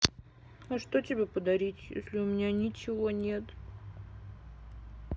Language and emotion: Russian, sad